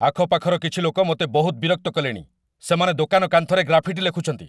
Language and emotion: Odia, angry